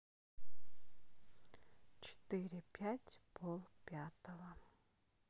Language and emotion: Russian, sad